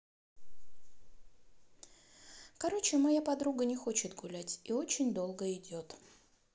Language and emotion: Russian, sad